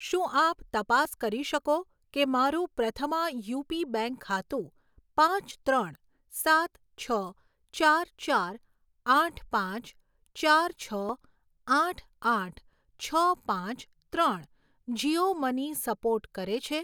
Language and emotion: Gujarati, neutral